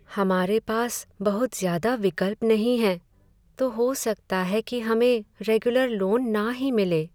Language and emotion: Hindi, sad